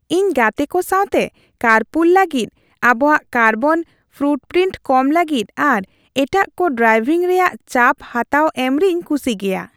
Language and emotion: Santali, happy